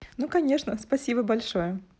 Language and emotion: Russian, positive